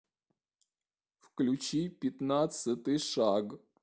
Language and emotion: Russian, neutral